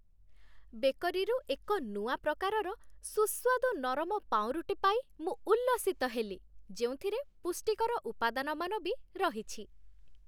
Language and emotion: Odia, happy